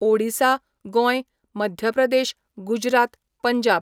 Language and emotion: Goan Konkani, neutral